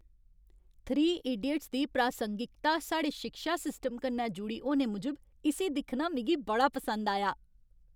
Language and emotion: Dogri, happy